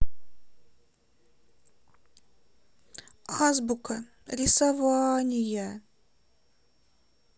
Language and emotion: Russian, sad